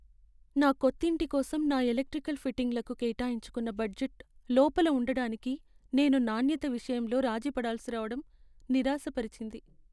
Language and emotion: Telugu, sad